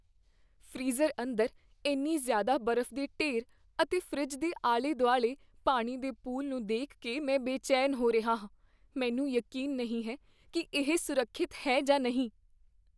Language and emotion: Punjabi, fearful